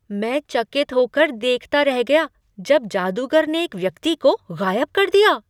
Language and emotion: Hindi, surprised